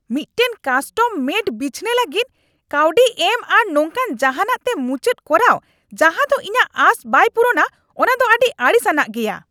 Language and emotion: Santali, angry